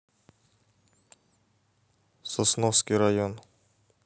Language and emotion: Russian, neutral